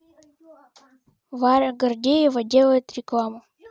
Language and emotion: Russian, neutral